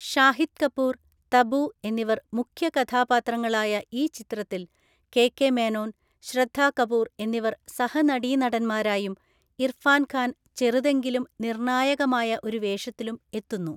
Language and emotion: Malayalam, neutral